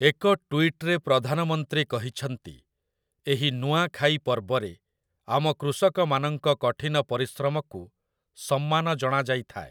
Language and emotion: Odia, neutral